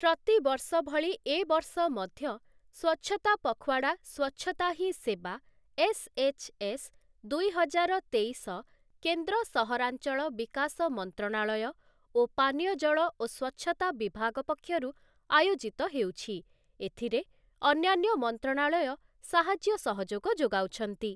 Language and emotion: Odia, neutral